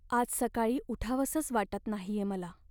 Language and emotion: Marathi, sad